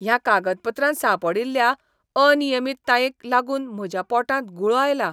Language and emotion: Goan Konkani, disgusted